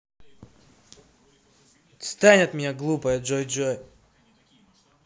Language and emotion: Russian, angry